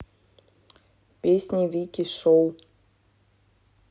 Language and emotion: Russian, neutral